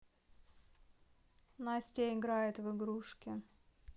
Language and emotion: Russian, neutral